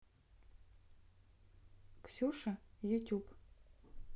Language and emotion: Russian, neutral